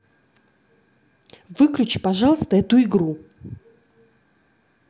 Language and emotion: Russian, angry